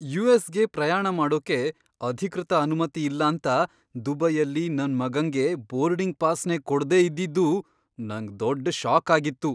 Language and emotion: Kannada, surprised